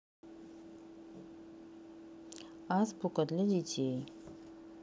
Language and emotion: Russian, neutral